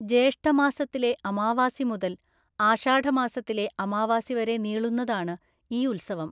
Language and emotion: Malayalam, neutral